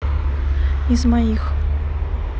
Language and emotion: Russian, neutral